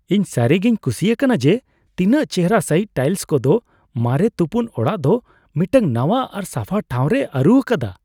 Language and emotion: Santali, happy